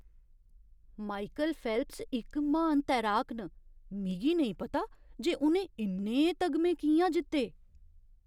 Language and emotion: Dogri, surprised